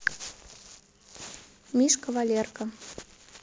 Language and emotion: Russian, neutral